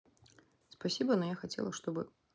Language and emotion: Russian, neutral